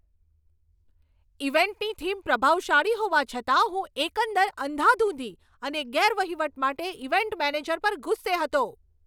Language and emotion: Gujarati, angry